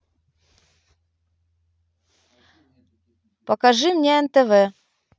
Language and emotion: Russian, neutral